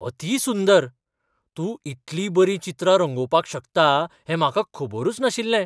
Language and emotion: Goan Konkani, surprised